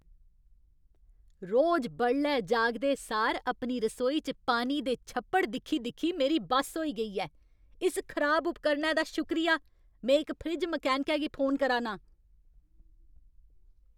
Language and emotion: Dogri, angry